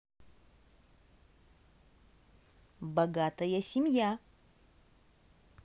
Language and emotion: Russian, positive